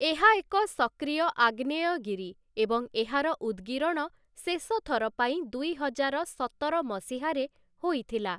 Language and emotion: Odia, neutral